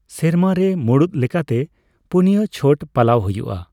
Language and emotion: Santali, neutral